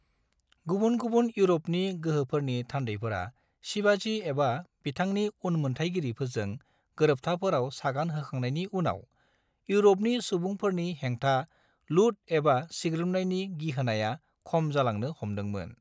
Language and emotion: Bodo, neutral